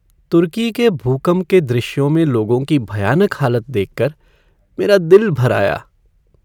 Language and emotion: Hindi, sad